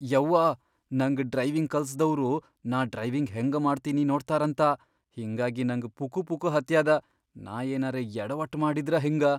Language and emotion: Kannada, fearful